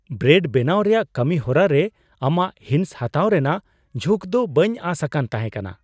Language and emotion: Santali, surprised